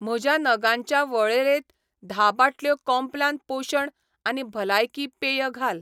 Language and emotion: Goan Konkani, neutral